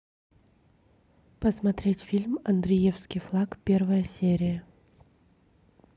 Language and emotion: Russian, neutral